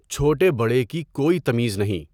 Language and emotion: Urdu, neutral